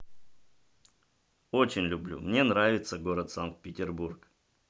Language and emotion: Russian, positive